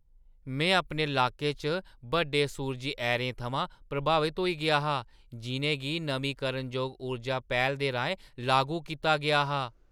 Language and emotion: Dogri, surprised